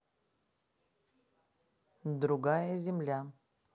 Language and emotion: Russian, neutral